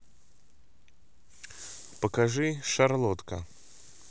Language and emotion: Russian, neutral